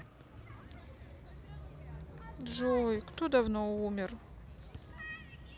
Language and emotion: Russian, sad